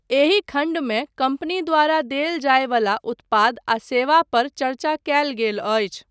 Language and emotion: Maithili, neutral